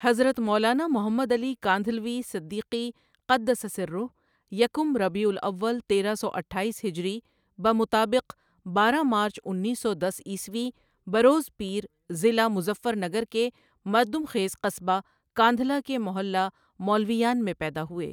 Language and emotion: Urdu, neutral